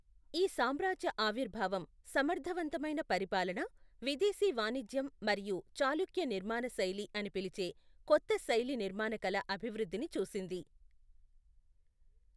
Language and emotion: Telugu, neutral